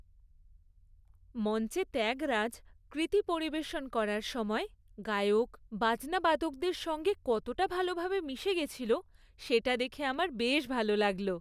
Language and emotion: Bengali, happy